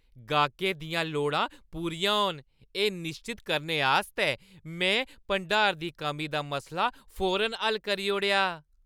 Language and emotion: Dogri, happy